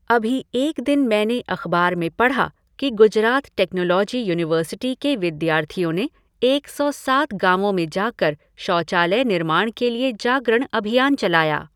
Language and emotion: Hindi, neutral